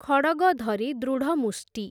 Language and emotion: Odia, neutral